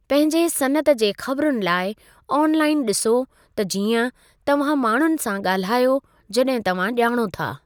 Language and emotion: Sindhi, neutral